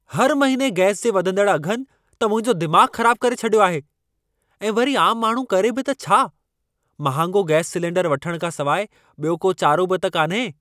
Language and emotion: Sindhi, angry